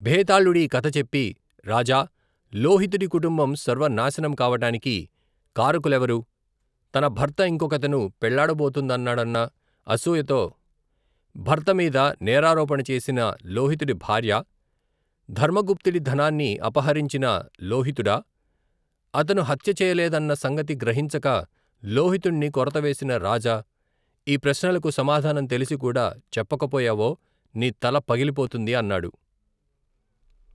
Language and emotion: Telugu, neutral